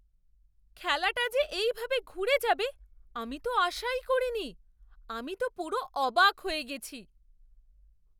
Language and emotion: Bengali, surprised